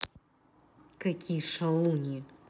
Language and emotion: Russian, angry